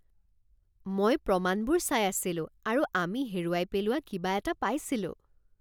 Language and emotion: Assamese, surprised